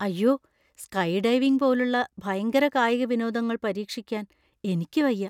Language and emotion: Malayalam, fearful